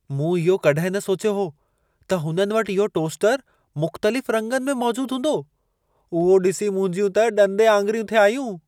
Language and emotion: Sindhi, surprised